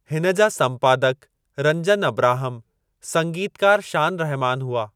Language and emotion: Sindhi, neutral